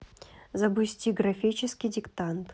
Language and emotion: Russian, neutral